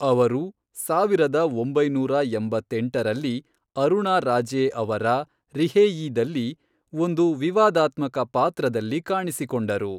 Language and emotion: Kannada, neutral